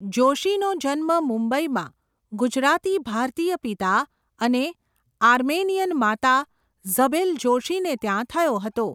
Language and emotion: Gujarati, neutral